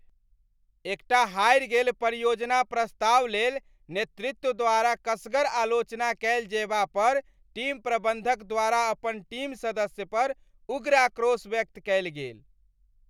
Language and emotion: Maithili, angry